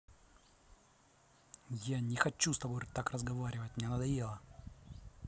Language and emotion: Russian, angry